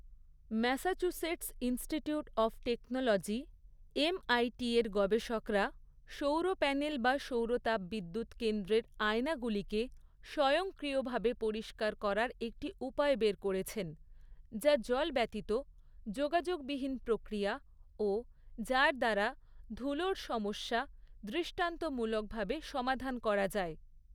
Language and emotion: Bengali, neutral